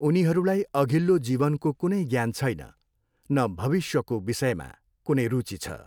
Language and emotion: Nepali, neutral